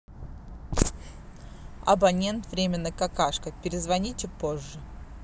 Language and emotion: Russian, neutral